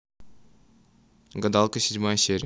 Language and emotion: Russian, neutral